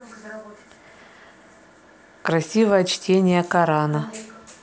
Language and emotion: Russian, neutral